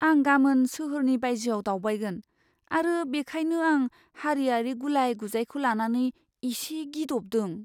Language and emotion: Bodo, fearful